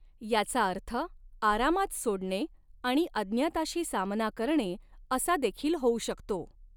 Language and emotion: Marathi, neutral